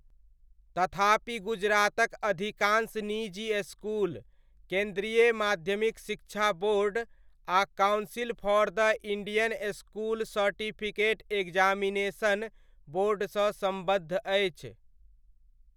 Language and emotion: Maithili, neutral